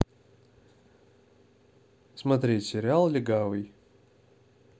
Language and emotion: Russian, neutral